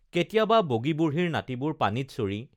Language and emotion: Assamese, neutral